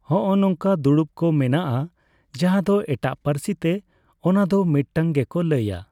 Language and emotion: Santali, neutral